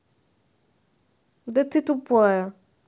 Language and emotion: Russian, neutral